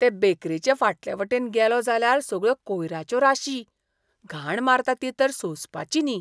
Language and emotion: Goan Konkani, disgusted